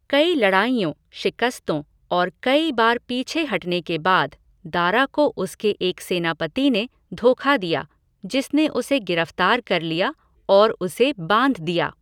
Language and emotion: Hindi, neutral